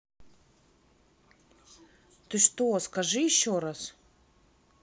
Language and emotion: Russian, neutral